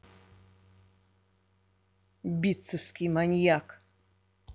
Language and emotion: Russian, angry